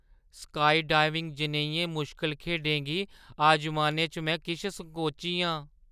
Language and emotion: Dogri, fearful